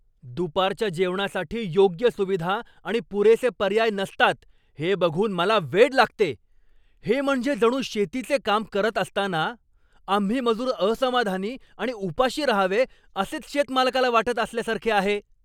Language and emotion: Marathi, angry